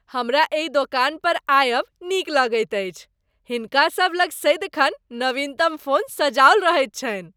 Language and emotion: Maithili, happy